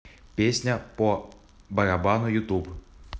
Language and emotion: Russian, neutral